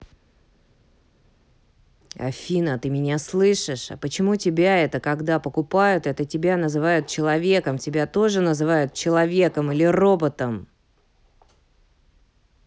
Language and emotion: Russian, angry